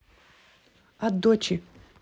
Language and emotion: Russian, neutral